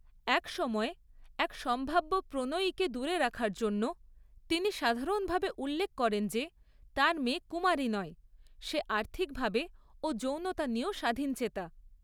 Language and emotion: Bengali, neutral